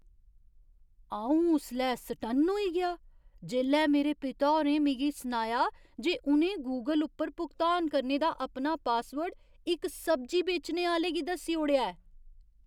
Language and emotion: Dogri, surprised